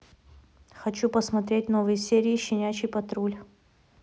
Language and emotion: Russian, neutral